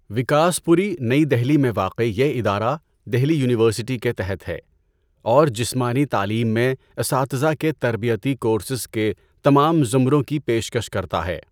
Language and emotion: Urdu, neutral